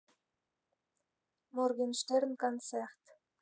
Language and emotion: Russian, neutral